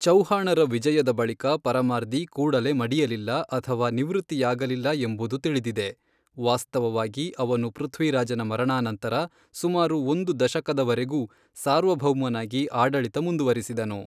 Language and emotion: Kannada, neutral